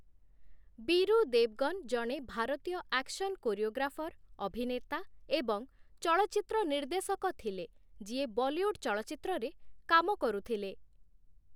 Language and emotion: Odia, neutral